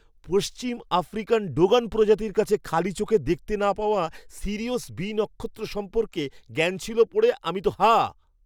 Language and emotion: Bengali, surprised